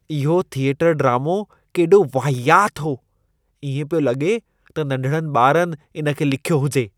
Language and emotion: Sindhi, disgusted